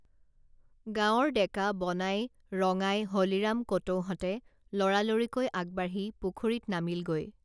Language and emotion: Assamese, neutral